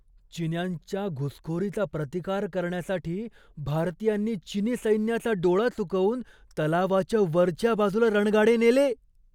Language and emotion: Marathi, surprised